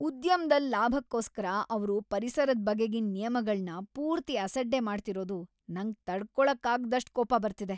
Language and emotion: Kannada, angry